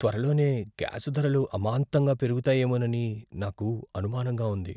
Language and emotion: Telugu, fearful